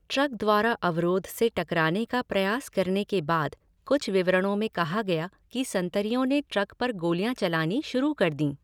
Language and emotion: Hindi, neutral